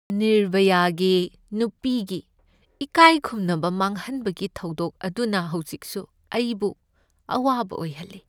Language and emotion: Manipuri, sad